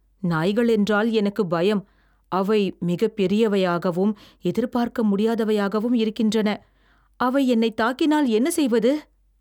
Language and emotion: Tamil, fearful